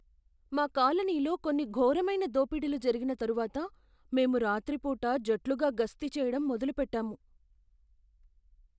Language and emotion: Telugu, fearful